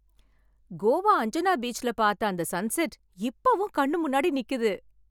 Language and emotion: Tamil, happy